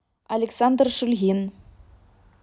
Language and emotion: Russian, neutral